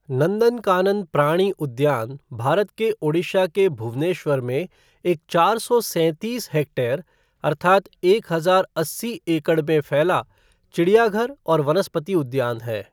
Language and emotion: Hindi, neutral